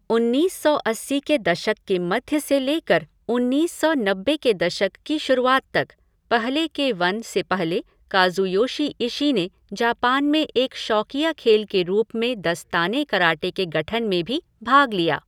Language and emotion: Hindi, neutral